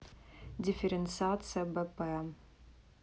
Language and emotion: Russian, neutral